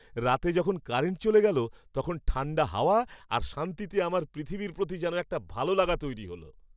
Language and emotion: Bengali, happy